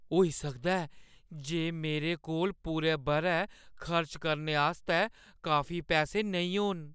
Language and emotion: Dogri, fearful